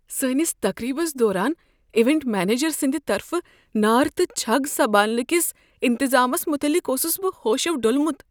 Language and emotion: Kashmiri, fearful